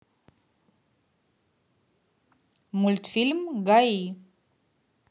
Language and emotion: Russian, neutral